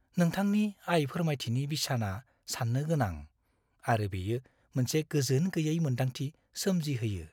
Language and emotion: Bodo, fearful